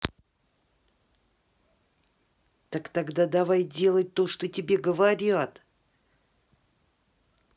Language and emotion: Russian, angry